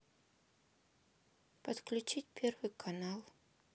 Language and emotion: Russian, neutral